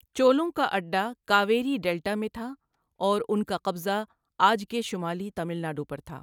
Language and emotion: Urdu, neutral